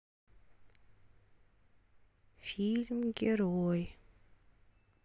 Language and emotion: Russian, sad